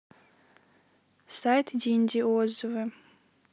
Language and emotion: Russian, neutral